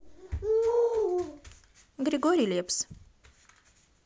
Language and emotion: Russian, neutral